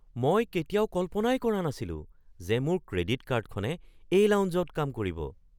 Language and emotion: Assamese, surprised